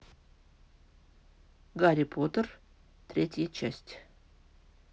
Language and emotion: Russian, neutral